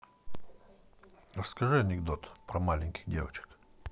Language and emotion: Russian, neutral